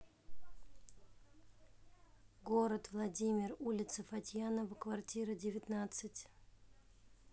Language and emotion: Russian, neutral